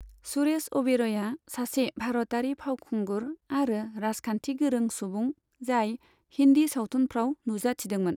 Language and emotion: Bodo, neutral